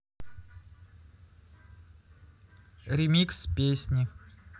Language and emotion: Russian, neutral